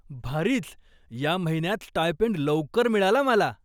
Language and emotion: Marathi, surprised